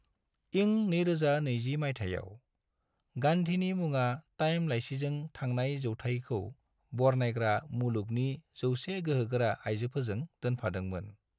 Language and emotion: Bodo, neutral